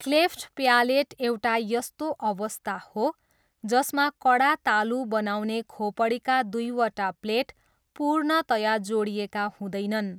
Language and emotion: Nepali, neutral